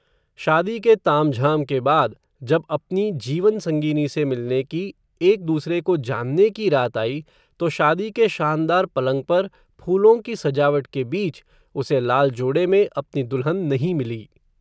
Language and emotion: Hindi, neutral